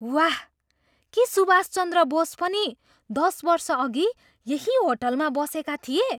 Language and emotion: Nepali, surprised